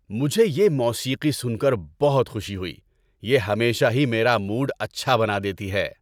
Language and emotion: Urdu, happy